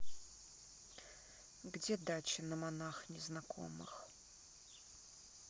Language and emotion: Russian, neutral